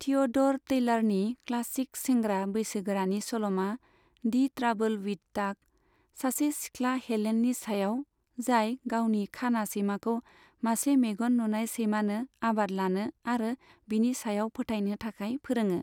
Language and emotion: Bodo, neutral